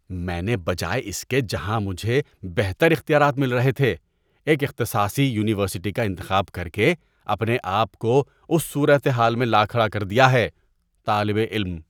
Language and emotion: Urdu, disgusted